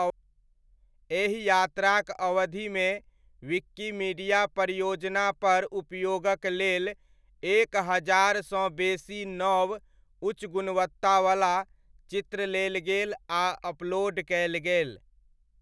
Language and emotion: Maithili, neutral